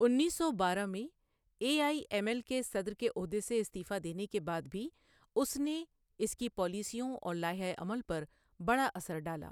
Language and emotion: Urdu, neutral